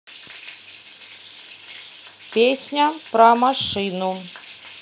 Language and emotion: Russian, neutral